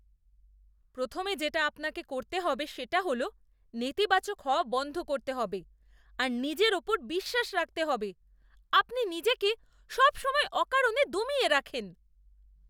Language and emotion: Bengali, disgusted